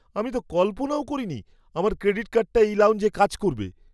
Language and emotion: Bengali, surprised